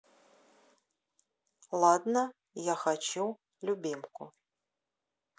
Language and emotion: Russian, neutral